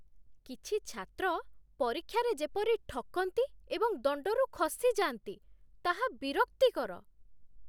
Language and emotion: Odia, disgusted